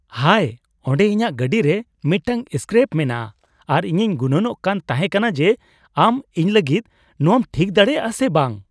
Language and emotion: Santali, surprised